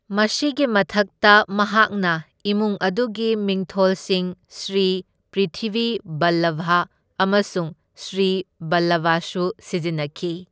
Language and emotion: Manipuri, neutral